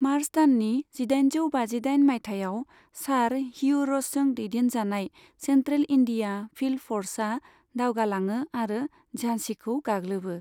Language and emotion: Bodo, neutral